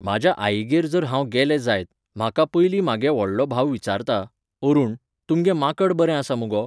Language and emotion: Goan Konkani, neutral